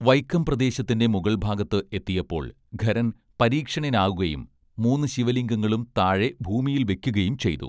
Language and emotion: Malayalam, neutral